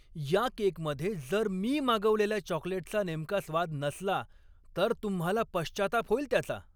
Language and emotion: Marathi, angry